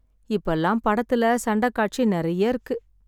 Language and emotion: Tamil, sad